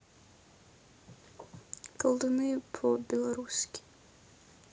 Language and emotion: Russian, neutral